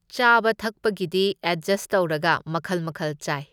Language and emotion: Manipuri, neutral